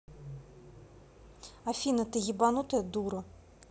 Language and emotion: Russian, angry